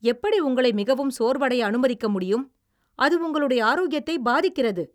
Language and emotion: Tamil, angry